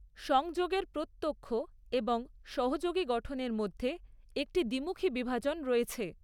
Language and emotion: Bengali, neutral